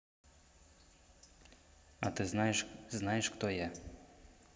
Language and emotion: Russian, neutral